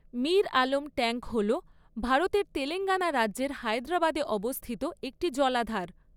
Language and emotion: Bengali, neutral